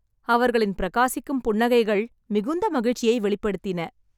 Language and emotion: Tamil, happy